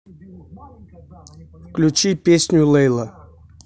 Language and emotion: Russian, neutral